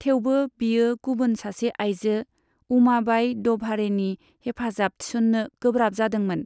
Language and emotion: Bodo, neutral